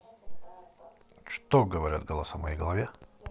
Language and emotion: Russian, neutral